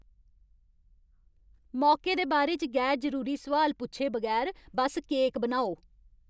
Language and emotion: Dogri, angry